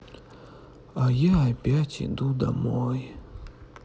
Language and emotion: Russian, sad